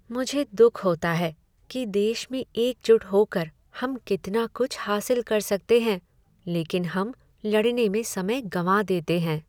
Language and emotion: Hindi, sad